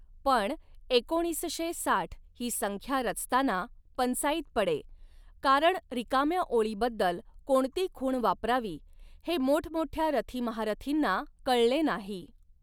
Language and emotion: Marathi, neutral